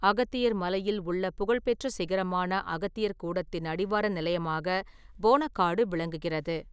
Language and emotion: Tamil, neutral